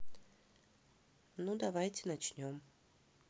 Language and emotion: Russian, neutral